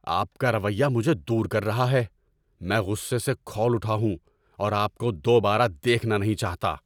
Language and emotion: Urdu, angry